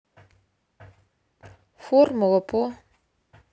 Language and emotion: Russian, neutral